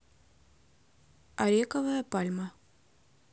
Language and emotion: Russian, neutral